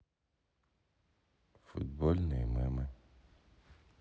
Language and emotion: Russian, neutral